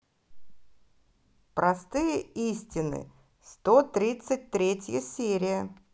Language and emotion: Russian, positive